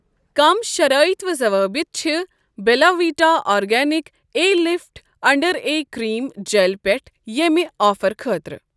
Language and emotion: Kashmiri, neutral